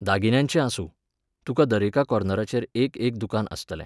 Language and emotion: Goan Konkani, neutral